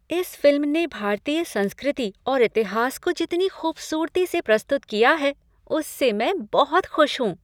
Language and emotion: Hindi, happy